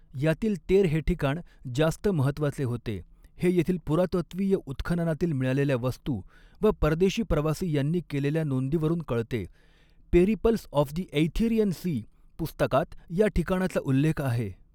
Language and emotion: Marathi, neutral